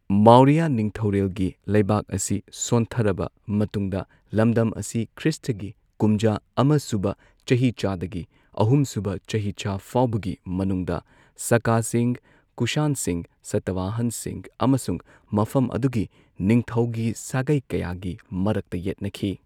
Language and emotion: Manipuri, neutral